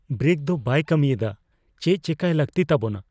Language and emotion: Santali, fearful